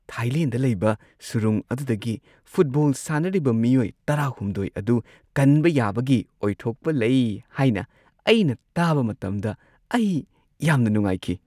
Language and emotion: Manipuri, happy